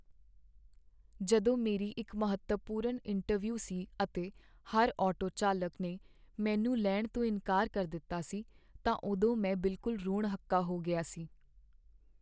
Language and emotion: Punjabi, sad